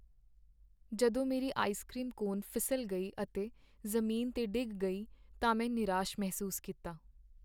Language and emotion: Punjabi, sad